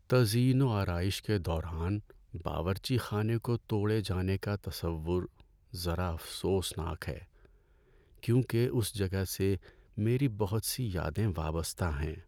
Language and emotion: Urdu, sad